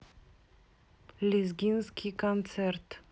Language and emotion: Russian, neutral